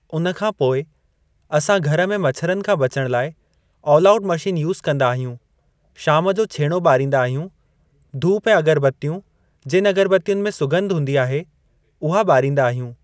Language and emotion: Sindhi, neutral